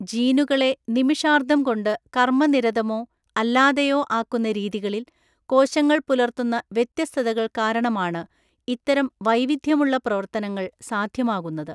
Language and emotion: Malayalam, neutral